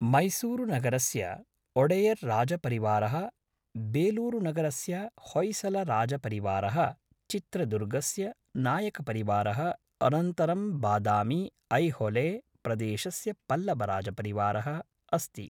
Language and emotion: Sanskrit, neutral